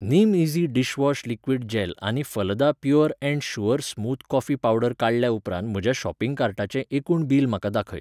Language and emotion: Goan Konkani, neutral